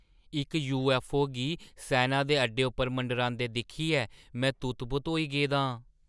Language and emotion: Dogri, surprised